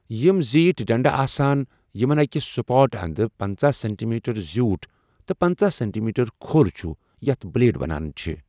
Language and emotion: Kashmiri, neutral